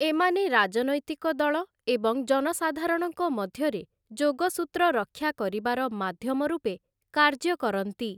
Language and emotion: Odia, neutral